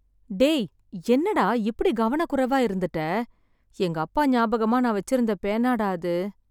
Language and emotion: Tamil, sad